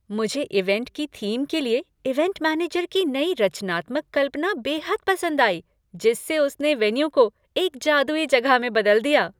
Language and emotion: Hindi, happy